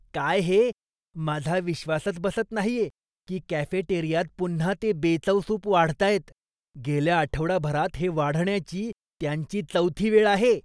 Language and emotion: Marathi, disgusted